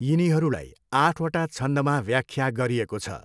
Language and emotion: Nepali, neutral